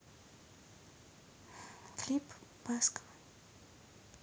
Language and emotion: Russian, neutral